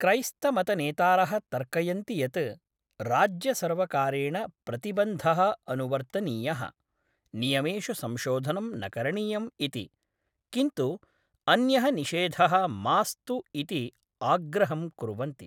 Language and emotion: Sanskrit, neutral